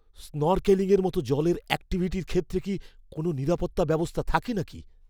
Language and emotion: Bengali, fearful